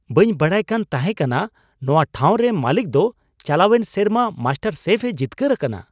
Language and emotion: Santali, surprised